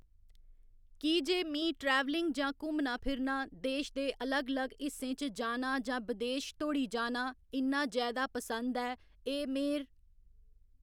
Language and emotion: Dogri, neutral